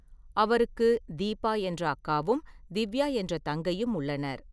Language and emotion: Tamil, neutral